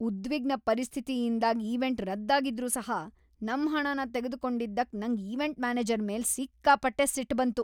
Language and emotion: Kannada, angry